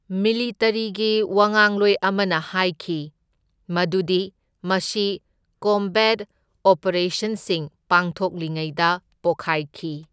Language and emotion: Manipuri, neutral